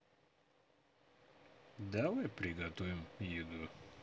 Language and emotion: Russian, neutral